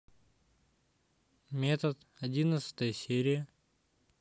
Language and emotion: Russian, neutral